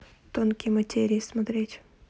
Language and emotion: Russian, neutral